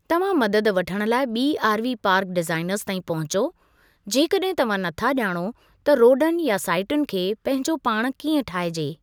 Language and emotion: Sindhi, neutral